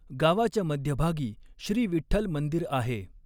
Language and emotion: Marathi, neutral